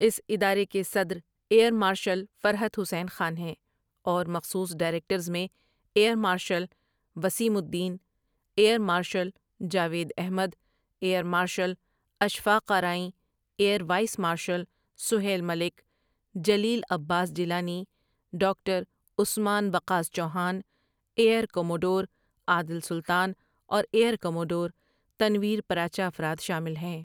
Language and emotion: Urdu, neutral